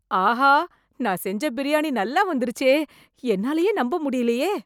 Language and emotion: Tamil, surprised